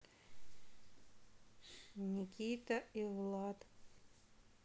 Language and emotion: Russian, sad